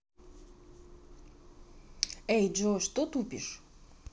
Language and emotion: Russian, neutral